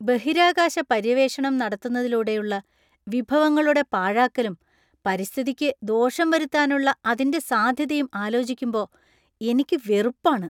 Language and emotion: Malayalam, disgusted